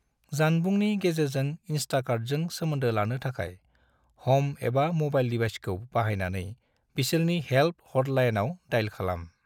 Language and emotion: Bodo, neutral